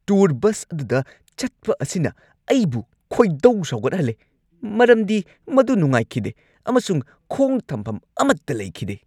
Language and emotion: Manipuri, angry